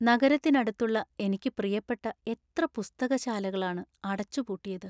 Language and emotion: Malayalam, sad